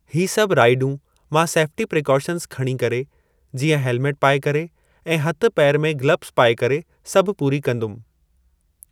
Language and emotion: Sindhi, neutral